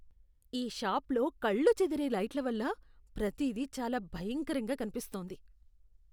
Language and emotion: Telugu, disgusted